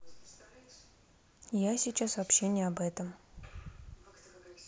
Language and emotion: Russian, neutral